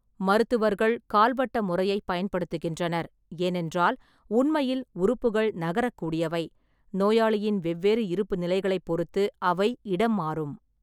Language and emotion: Tamil, neutral